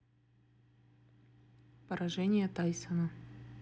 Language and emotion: Russian, neutral